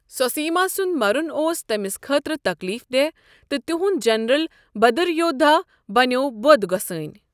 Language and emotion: Kashmiri, neutral